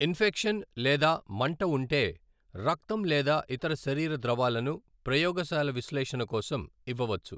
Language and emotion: Telugu, neutral